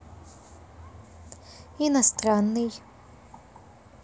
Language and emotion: Russian, neutral